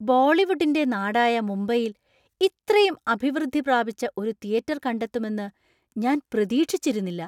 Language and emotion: Malayalam, surprised